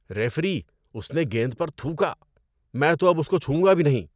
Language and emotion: Urdu, disgusted